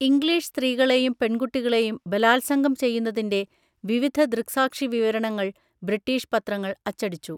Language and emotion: Malayalam, neutral